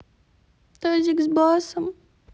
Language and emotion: Russian, sad